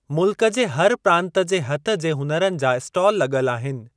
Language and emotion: Sindhi, neutral